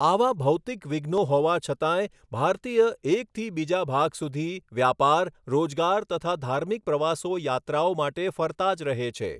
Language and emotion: Gujarati, neutral